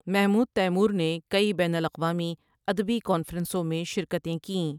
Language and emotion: Urdu, neutral